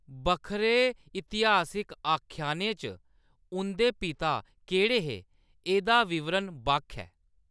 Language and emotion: Dogri, neutral